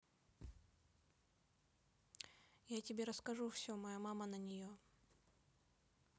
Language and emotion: Russian, neutral